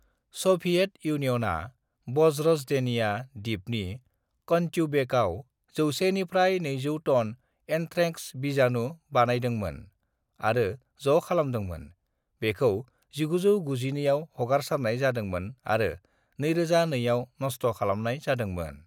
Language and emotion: Bodo, neutral